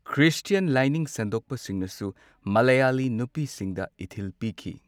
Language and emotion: Manipuri, neutral